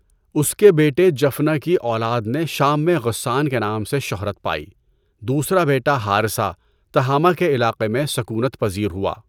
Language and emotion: Urdu, neutral